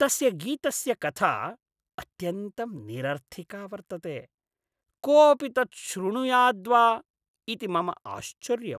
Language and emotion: Sanskrit, disgusted